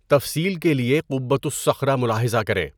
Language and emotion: Urdu, neutral